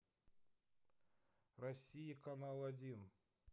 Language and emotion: Russian, neutral